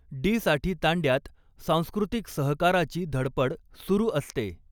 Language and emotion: Marathi, neutral